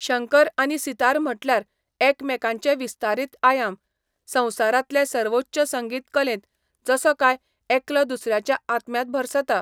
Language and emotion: Goan Konkani, neutral